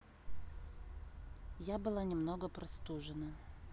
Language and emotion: Russian, neutral